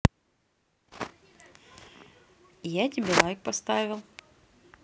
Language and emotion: Russian, neutral